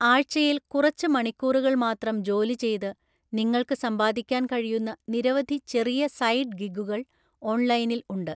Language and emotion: Malayalam, neutral